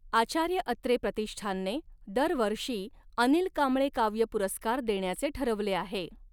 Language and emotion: Marathi, neutral